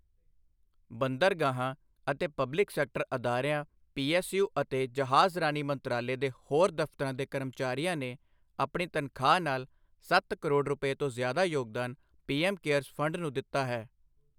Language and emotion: Punjabi, neutral